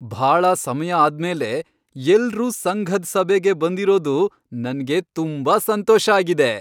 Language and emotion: Kannada, happy